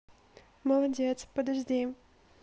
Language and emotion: Russian, neutral